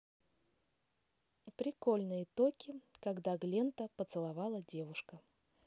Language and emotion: Russian, neutral